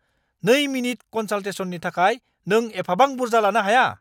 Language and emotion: Bodo, angry